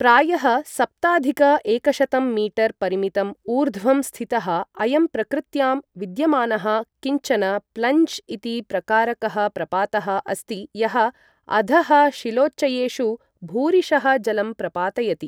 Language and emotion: Sanskrit, neutral